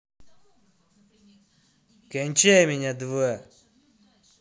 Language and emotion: Russian, angry